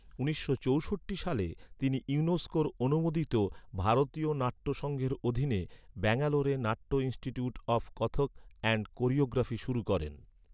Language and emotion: Bengali, neutral